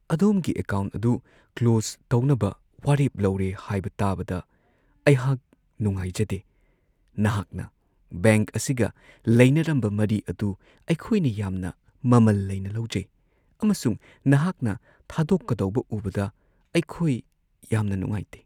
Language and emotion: Manipuri, sad